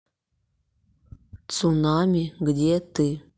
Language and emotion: Russian, neutral